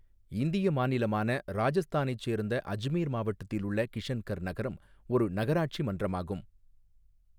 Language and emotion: Tamil, neutral